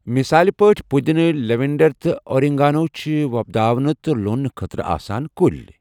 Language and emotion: Kashmiri, neutral